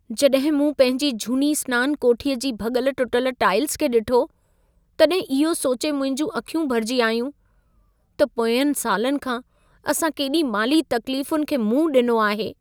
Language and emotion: Sindhi, sad